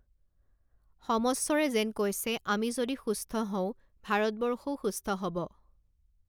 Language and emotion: Assamese, neutral